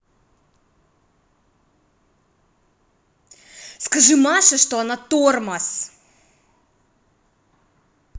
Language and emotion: Russian, angry